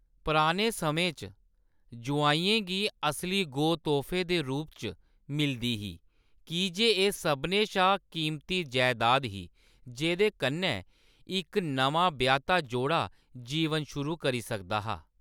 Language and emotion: Dogri, neutral